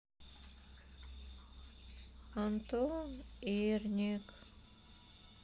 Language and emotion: Russian, sad